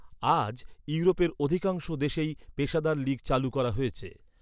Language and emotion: Bengali, neutral